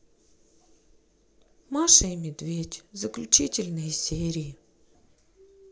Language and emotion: Russian, sad